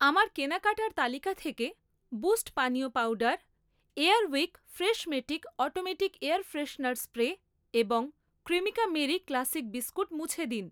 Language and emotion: Bengali, neutral